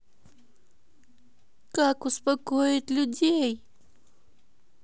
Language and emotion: Russian, sad